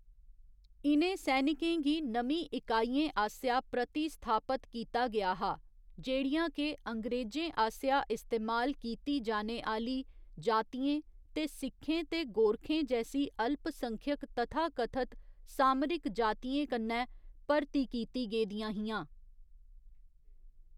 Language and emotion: Dogri, neutral